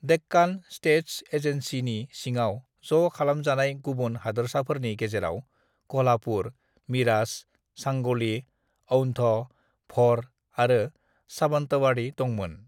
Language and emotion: Bodo, neutral